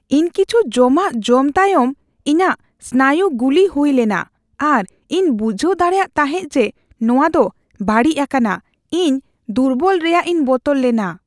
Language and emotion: Santali, fearful